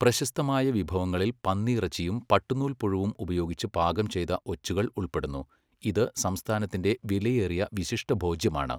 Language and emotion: Malayalam, neutral